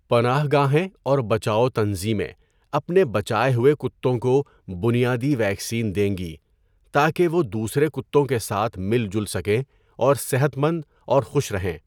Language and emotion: Urdu, neutral